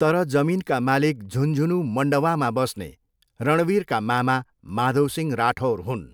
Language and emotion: Nepali, neutral